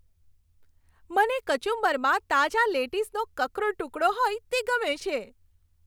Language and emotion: Gujarati, happy